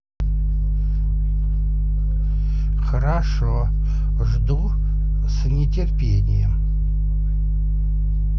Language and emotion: Russian, neutral